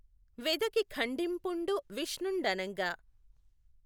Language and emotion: Telugu, neutral